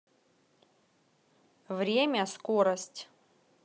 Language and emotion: Russian, neutral